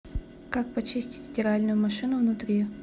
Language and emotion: Russian, neutral